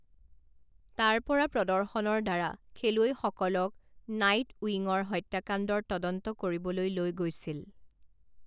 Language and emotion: Assamese, neutral